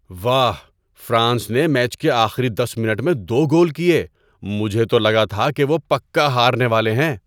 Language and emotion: Urdu, surprised